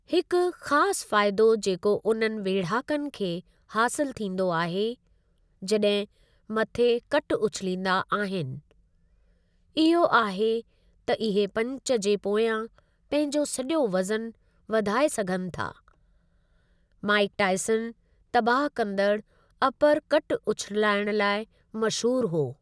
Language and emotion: Sindhi, neutral